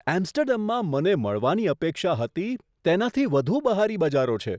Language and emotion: Gujarati, surprised